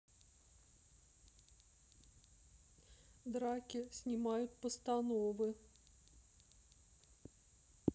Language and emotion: Russian, sad